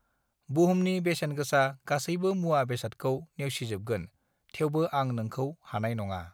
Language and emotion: Bodo, neutral